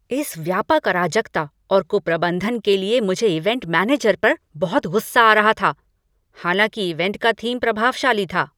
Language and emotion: Hindi, angry